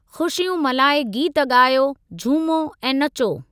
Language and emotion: Sindhi, neutral